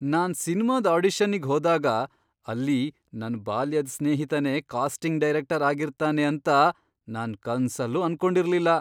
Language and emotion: Kannada, surprised